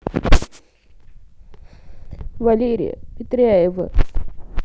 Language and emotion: Russian, sad